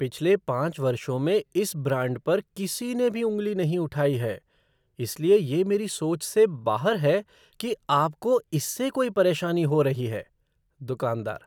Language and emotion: Hindi, surprised